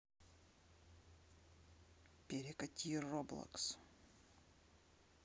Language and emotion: Russian, neutral